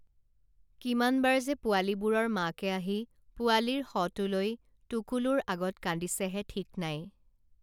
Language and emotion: Assamese, neutral